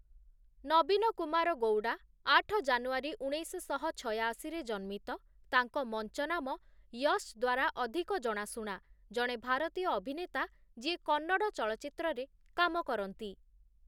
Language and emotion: Odia, neutral